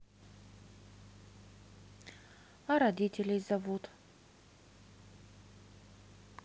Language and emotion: Russian, neutral